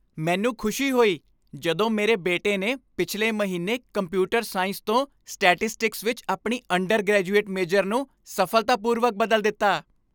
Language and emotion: Punjabi, happy